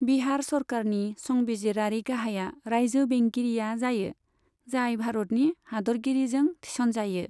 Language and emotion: Bodo, neutral